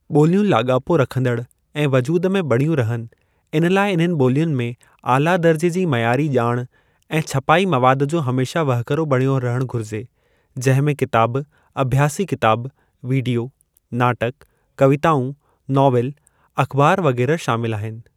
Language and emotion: Sindhi, neutral